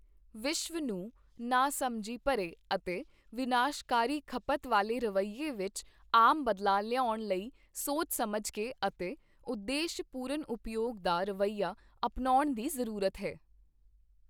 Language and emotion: Punjabi, neutral